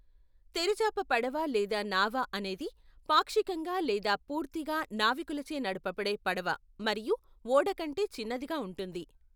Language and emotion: Telugu, neutral